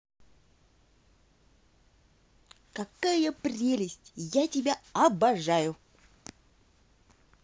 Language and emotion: Russian, positive